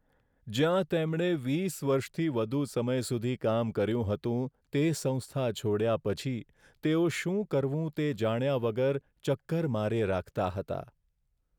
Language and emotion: Gujarati, sad